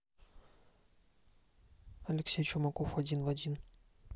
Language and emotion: Russian, neutral